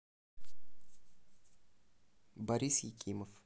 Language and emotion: Russian, neutral